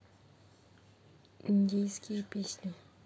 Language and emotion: Russian, neutral